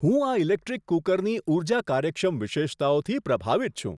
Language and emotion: Gujarati, surprised